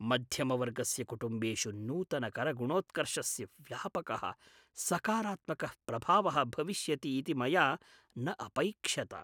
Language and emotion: Sanskrit, surprised